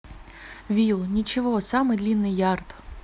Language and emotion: Russian, neutral